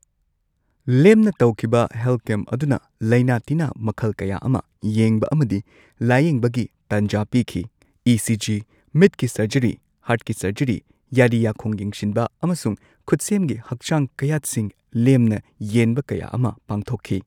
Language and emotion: Manipuri, neutral